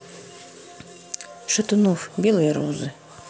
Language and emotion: Russian, neutral